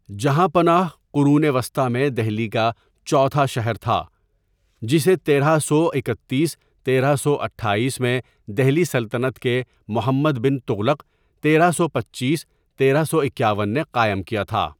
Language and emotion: Urdu, neutral